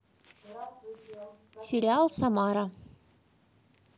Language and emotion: Russian, neutral